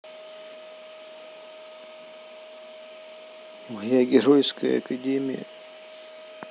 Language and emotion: Russian, sad